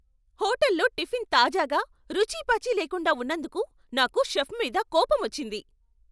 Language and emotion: Telugu, angry